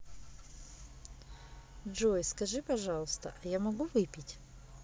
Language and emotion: Russian, neutral